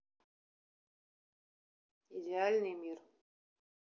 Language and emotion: Russian, neutral